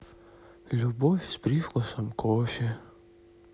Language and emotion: Russian, sad